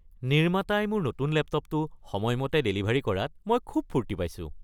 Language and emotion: Assamese, happy